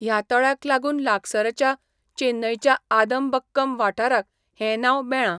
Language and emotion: Goan Konkani, neutral